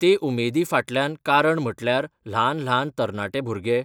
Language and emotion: Goan Konkani, neutral